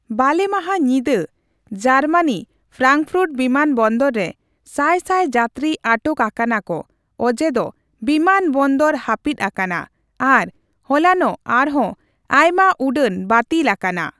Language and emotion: Santali, neutral